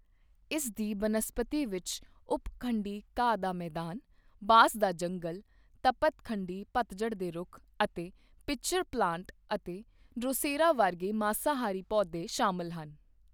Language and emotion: Punjabi, neutral